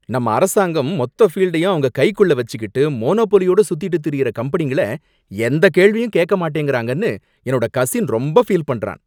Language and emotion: Tamil, angry